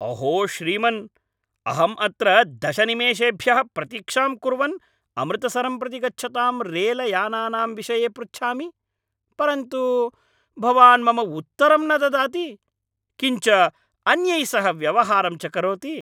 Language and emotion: Sanskrit, angry